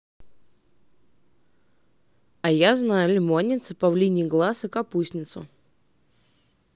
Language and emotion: Russian, neutral